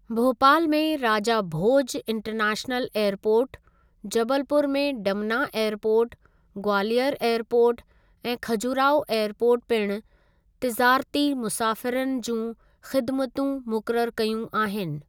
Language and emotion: Sindhi, neutral